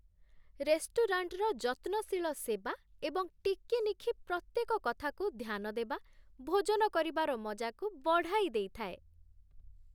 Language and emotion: Odia, happy